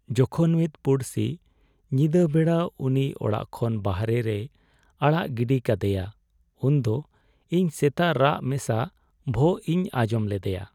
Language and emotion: Santali, sad